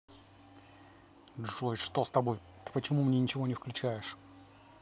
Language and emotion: Russian, angry